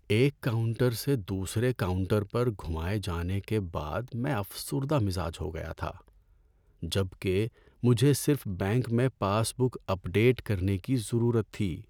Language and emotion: Urdu, sad